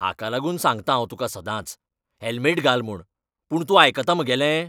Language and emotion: Goan Konkani, angry